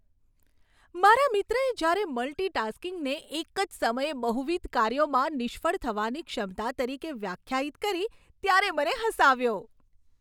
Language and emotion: Gujarati, happy